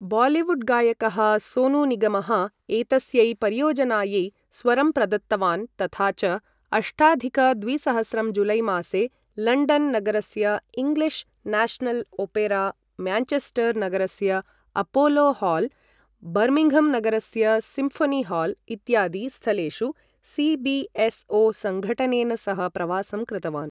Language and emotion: Sanskrit, neutral